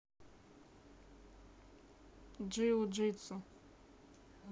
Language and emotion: Russian, neutral